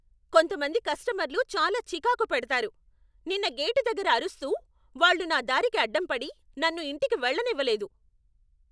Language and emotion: Telugu, angry